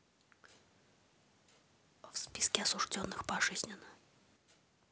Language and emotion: Russian, neutral